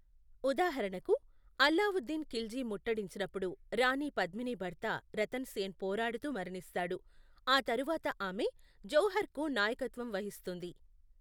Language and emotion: Telugu, neutral